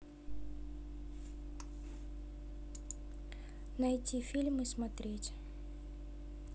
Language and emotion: Russian, neutral